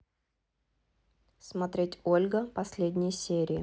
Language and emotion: Russian, neutral